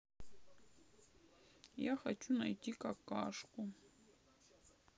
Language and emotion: Russian, sad